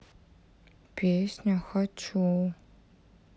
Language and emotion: Russian, sad